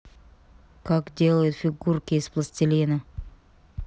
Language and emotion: Russian, neutral